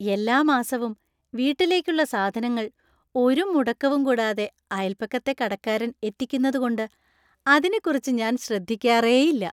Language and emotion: Malayalam, happy